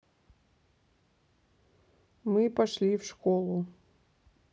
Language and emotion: Russian, neutral